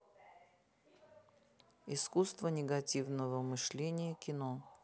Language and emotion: Russian, neutral